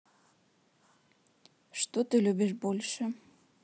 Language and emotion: Russian, neutral